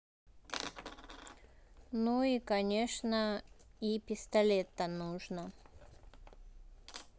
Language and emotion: Russian, neutral